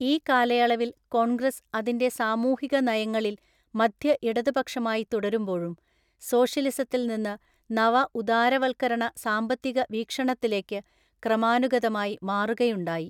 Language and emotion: Malayalam, neutral